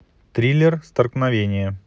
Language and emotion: Russian, neutral